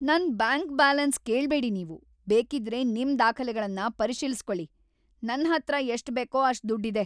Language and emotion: Kannada, angry